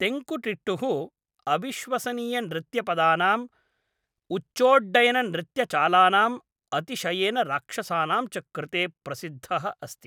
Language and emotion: Sanskrit, neutral